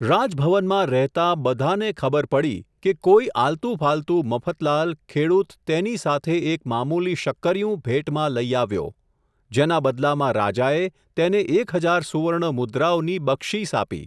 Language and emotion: Gujarati, neutral